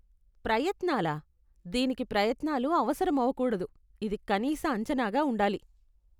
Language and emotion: Telugu, disgusted